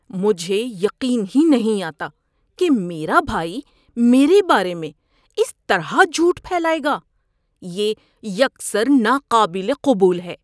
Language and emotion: Urdu, disgusted